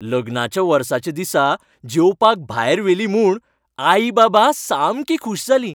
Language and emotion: Goan Konkani, happy